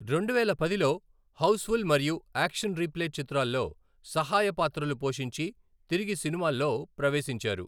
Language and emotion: Telugu, neutral